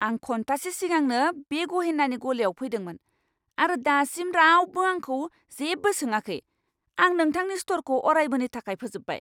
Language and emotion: Bodo, angry